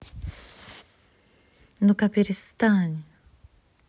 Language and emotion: Russian, angry